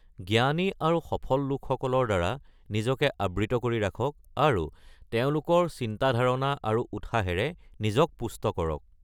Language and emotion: Assamese, neutral